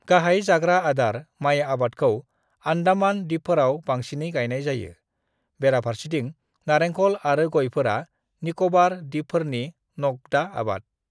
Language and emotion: Bodo, neutral